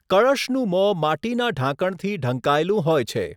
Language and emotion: Gujarati, neutral